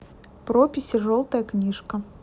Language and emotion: Russian, neutral